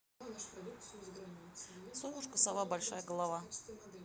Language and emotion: Russian, neutral